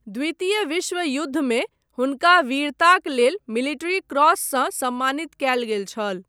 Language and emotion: Maithili, neutral